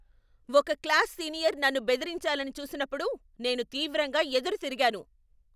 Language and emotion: Telugu, angry